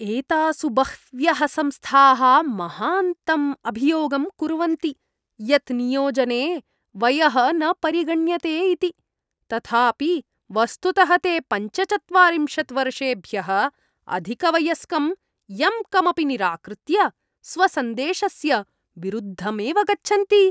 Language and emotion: Sanskrit, disgusted